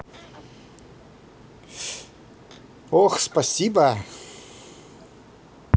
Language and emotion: Russian, positive